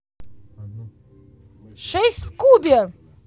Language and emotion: Russian, positive